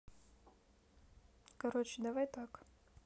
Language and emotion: Russian, neutral